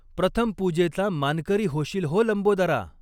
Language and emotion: Marathi, neutral